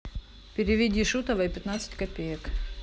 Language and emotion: Russian, neutral